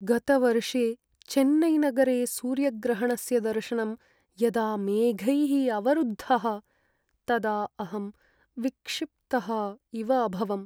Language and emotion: Sanskrit, sad